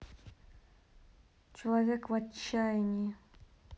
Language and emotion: Russian, sad